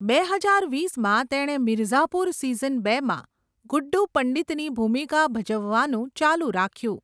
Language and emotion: Gujarati, neutral